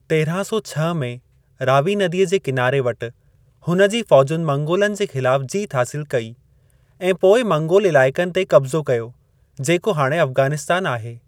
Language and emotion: Sindhi, neutral